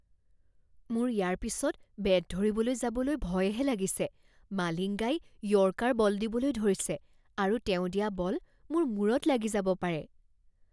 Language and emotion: Assamese, fearful